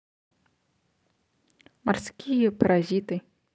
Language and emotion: Russian, neutral